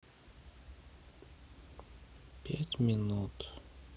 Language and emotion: Russian, sad